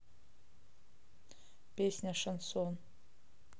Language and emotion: Russian, neutral